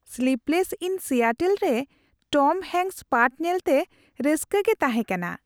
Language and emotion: Santali, happy